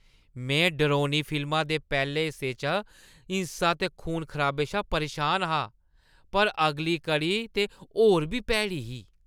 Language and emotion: Dogri, disgusted